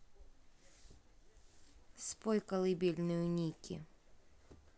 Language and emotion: Russian, neutral